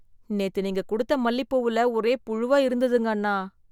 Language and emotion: Tamil, disgusted